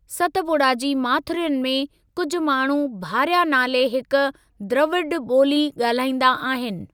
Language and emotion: Sindhi, neutral